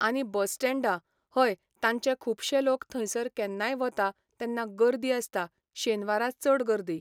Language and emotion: Goan Konkani, neutral